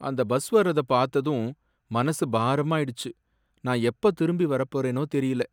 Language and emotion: Tamil, sad